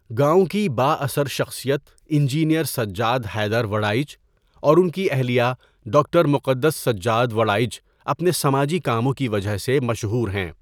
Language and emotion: Urdu, neutral